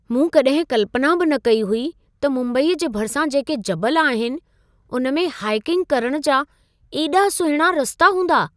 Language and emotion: Sindhi, surprised